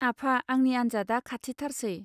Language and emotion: Bodo, neutral